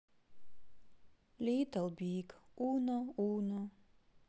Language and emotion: Russian, sad